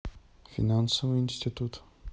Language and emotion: Russian, neutral